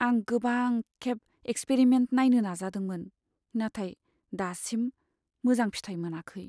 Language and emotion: Bodo, sad